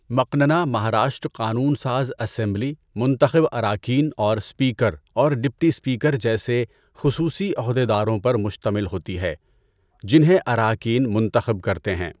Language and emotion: Urdu, neutral